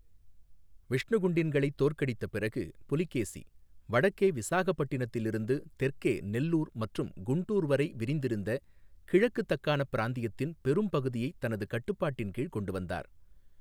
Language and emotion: Tamil, neutral